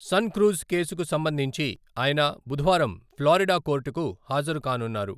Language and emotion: Telugu, neutral